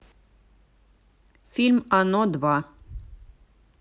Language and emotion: Russian, neutral